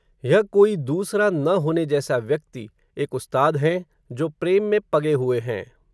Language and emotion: Hindi, neutral